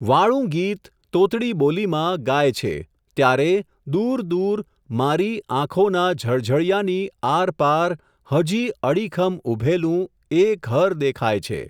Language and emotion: Gujarati, neutral